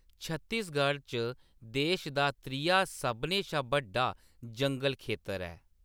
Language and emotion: Dogri, neutral